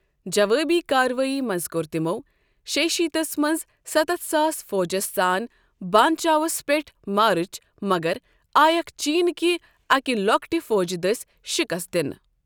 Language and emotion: Kashmiri, neutral